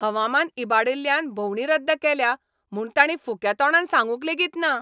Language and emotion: Goan Konkani, angry